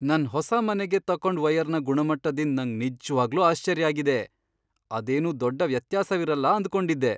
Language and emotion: Kannada, surprised